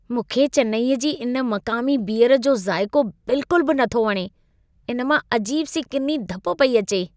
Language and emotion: Sindhi, disgusted